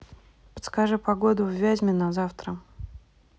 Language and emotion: Russian, neutral